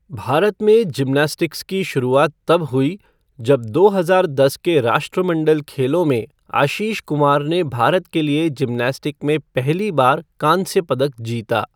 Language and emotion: Hindi, neutral